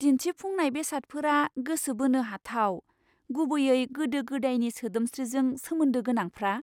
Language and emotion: Bodo, surprised